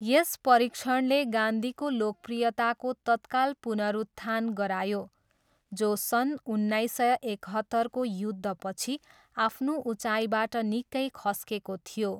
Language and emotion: Nepali, neutral